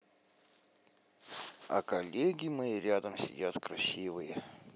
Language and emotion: Russian, positive